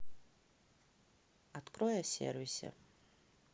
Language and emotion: Russian, neutral